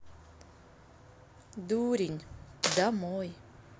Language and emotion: Russian, neutral